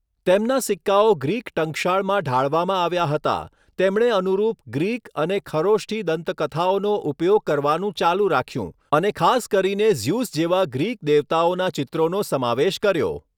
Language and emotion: Gujarati, neutral